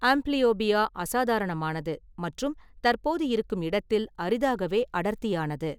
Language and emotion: Tamil, neutral